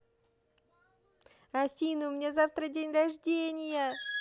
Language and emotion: Russian, positive